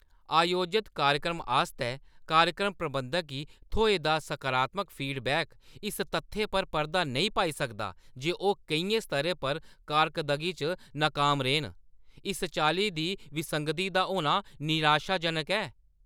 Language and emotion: Dogri, angry